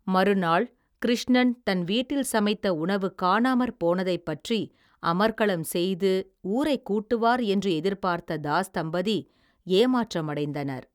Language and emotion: Tamil, neutral